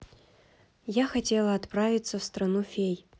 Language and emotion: Russian, neutral